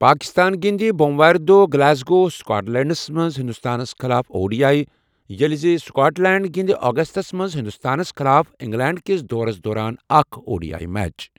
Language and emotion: Kashmiri, neutral